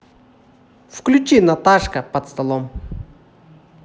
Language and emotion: Russian, positive